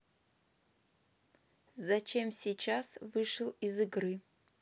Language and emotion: Russian, neutral